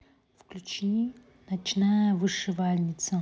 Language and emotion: Russian, neutral